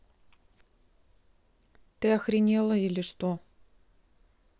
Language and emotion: Russian, neutral